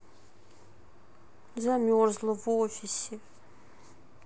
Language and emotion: Russian, sad